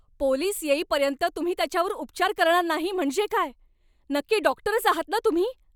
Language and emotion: Marathi, angry